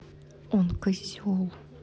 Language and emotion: Russian, angry